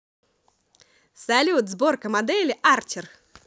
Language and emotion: Russian, positive